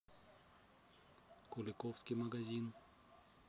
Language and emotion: Russian, neutral